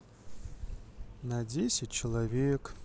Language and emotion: Russian, sad